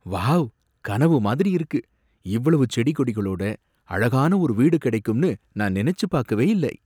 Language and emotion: Tamil, surprised